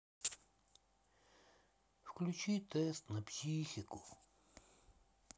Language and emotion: Russian, sad